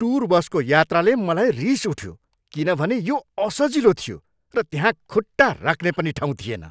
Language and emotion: Nepali, angry